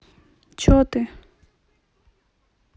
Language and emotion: Russian, neutral